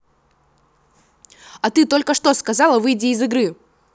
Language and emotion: Russian, angry